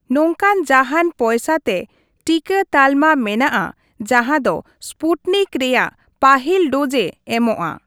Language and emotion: Santali, neutral